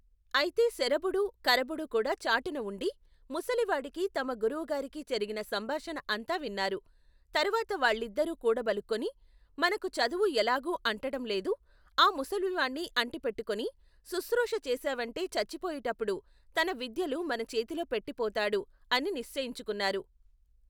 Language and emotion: Telugu, neutral